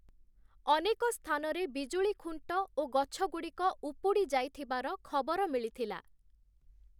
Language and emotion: Odia, neutral